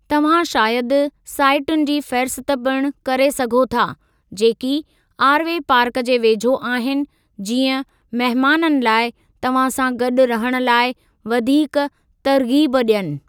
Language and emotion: Sindhi, neutral